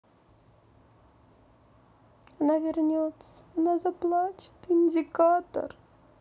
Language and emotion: Russian, sad